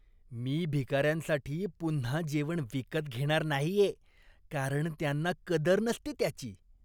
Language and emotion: Marathi, disgusted